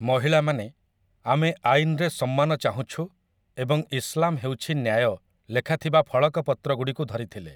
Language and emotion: Odia, neutral